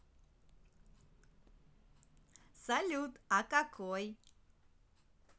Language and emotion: Russian, positive